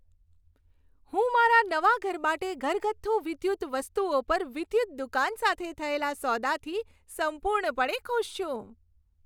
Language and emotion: Gujarati, happy